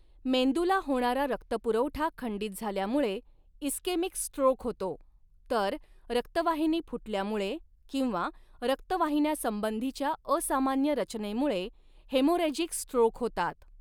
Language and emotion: Marathi, neutral